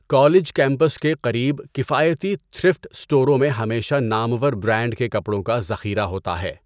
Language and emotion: Urdu, neutral